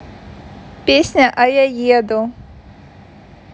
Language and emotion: Russian, neutral